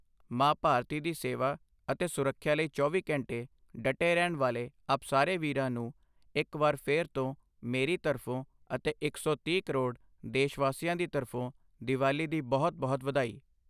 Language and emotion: Punjabi, neutral